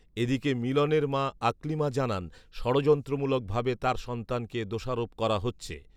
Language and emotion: Bengali, neutral